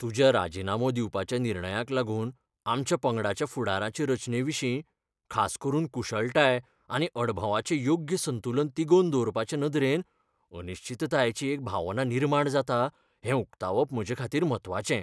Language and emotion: Goan Konkani, fearful